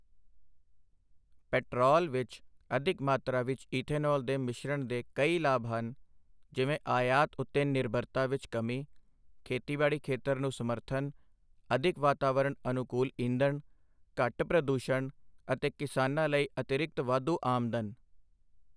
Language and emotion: Punjabi, neutral